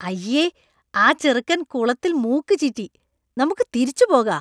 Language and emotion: Malayalam, disgusted